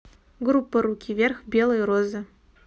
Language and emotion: Russian, neutral